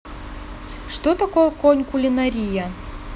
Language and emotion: Russian, neutral